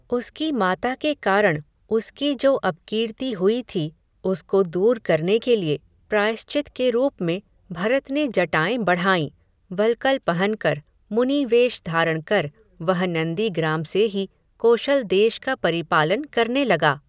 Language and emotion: Hindi, neutral